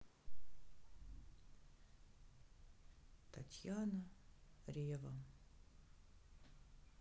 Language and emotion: Russian, sad